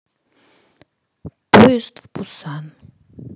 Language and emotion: Russian, neutral